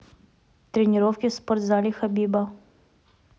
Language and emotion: Russian, neutral